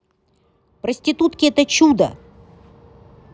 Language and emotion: Russian, positive